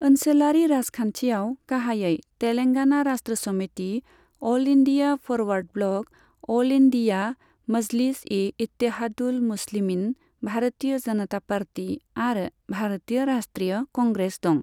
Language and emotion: Bodo, neutral